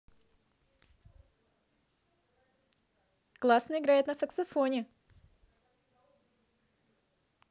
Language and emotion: Russian, positive